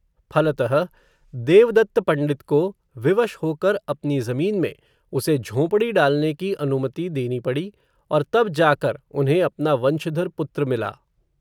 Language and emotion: Hindi, neutral